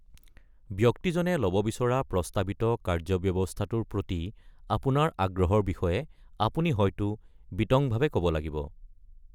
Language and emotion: Assamese, neutral